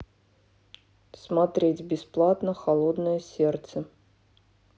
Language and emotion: Russian, neutral